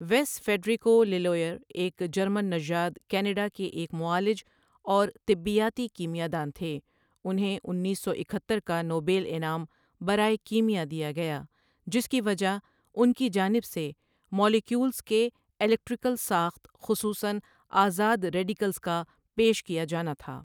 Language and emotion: Urdu, neutral